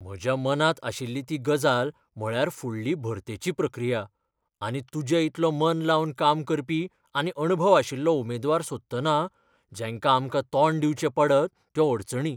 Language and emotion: Goan Konkani, fearful